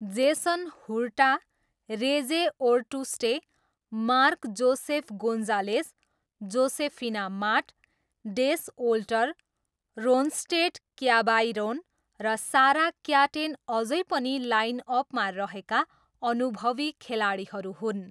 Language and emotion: Nepali, neutral